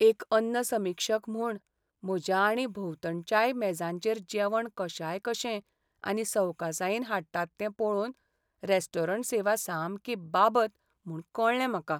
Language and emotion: Goan Konkani, sad